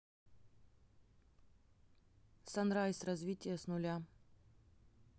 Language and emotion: Russian, neutral